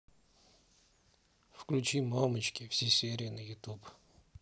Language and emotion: Russian, neutral